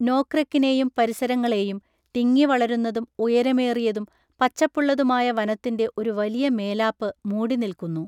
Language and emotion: Malayalam, neutral